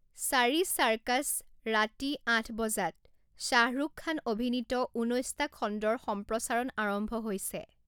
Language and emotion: Assamese, neutral